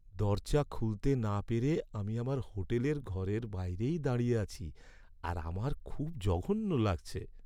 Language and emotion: Bengali, sad